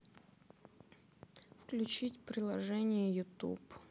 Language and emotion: Russian, sad